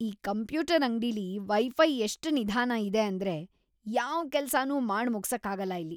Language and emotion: Kannada, disgusted